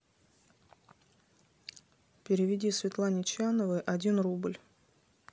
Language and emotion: Russian, neutral